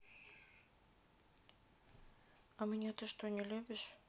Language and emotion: Russian, neutral